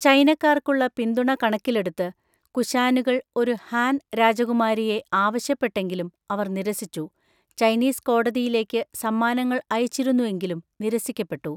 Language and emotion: Malayalam, neutral